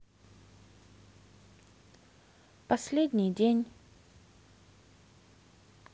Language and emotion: Russian, sad